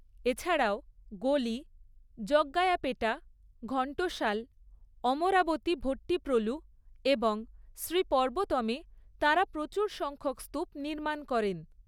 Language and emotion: Bengali, neutral